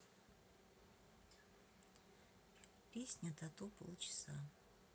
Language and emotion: Russian, neutral